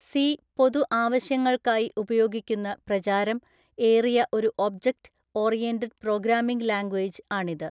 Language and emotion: Malayalam, neutral